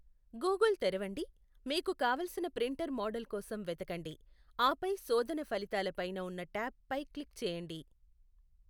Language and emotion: Telugu, neutral